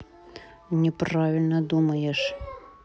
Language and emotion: Russian, angry